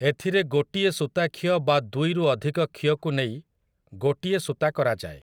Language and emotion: Odia, neutral